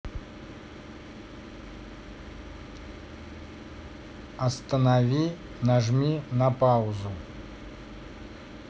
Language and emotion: Russian, neutral